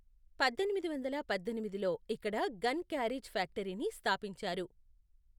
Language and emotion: Telugu, neutral